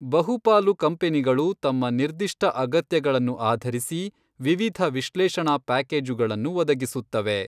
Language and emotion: Kannada, neutral